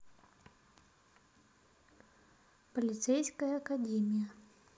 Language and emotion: Russian, neutral